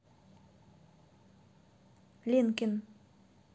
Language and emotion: Russian, neutral